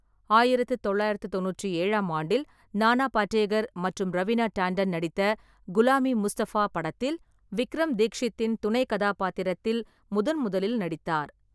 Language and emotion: Tamil, neutral